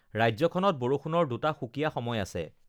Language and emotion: Assamese, neutral